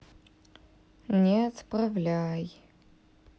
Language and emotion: Russian, neutral